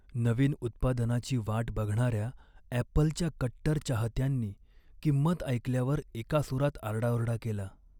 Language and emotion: Marathi, sad